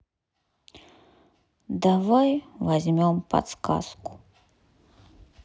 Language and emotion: Russian, sad